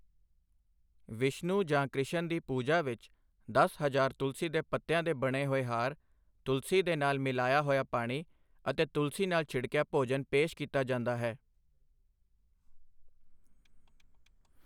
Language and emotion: Punjabi, neutral